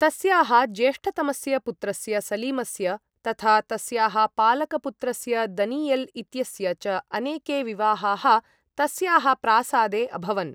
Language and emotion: Sanskrit, neutral